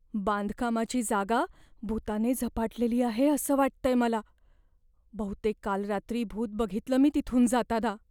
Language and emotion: Marathi, fearful